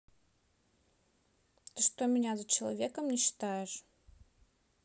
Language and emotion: Russian, sad